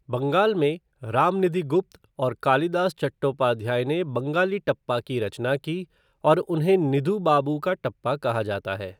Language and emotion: Hindi, neutral